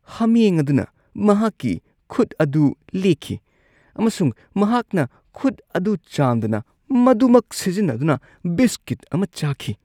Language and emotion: Manipuri, disgusted